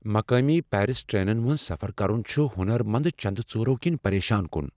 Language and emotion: Kashmiri, fearful